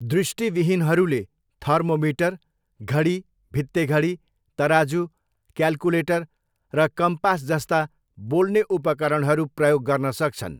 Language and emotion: Nepali, neutral